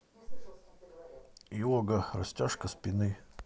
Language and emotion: Russian, neutral